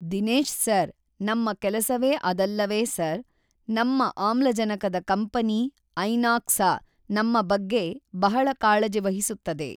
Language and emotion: Kannada, neutral